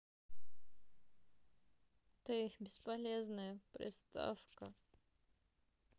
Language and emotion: Russian, sad